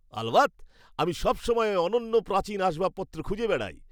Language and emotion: Bengali, happy